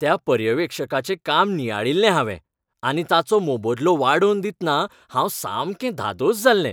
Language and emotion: Goan Konkani, happy